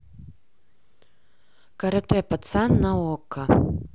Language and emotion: Russian, neutral